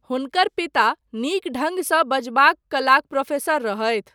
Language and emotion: Maithili, neutral